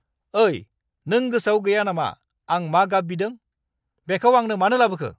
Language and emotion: Bodo, angry